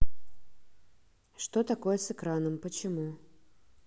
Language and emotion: Russian, neutral